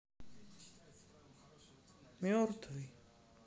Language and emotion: Russian, sad